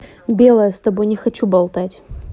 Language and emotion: Russian, angry